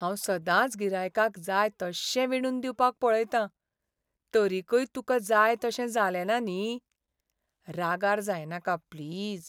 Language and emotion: Goan Konkani, sad